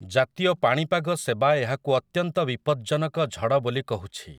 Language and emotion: Odia, neutral